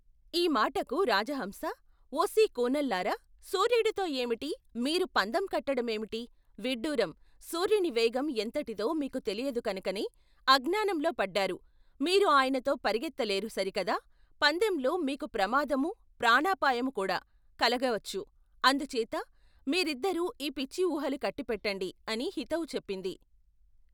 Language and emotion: Telugu, neutral